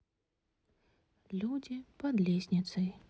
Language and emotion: Russian, neutral